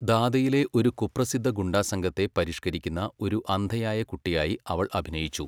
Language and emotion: Malayalam, neutral